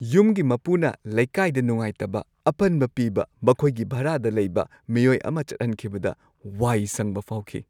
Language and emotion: Manipuri, happy